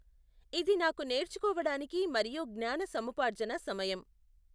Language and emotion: Telugu, neutral